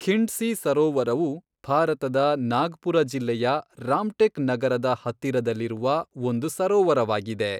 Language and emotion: Kannada, neutral